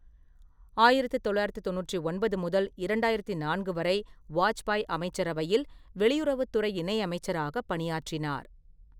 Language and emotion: Tamil, neutral